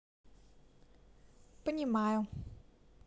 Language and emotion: Russian, neutral